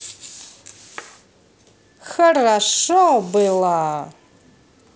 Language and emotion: Russian, positive